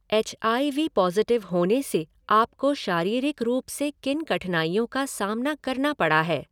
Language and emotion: Hindi, neutral